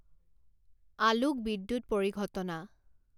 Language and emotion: Assamese, neutral